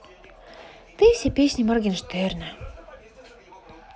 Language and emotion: Russian, sad